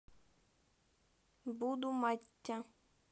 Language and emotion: Russian, neutral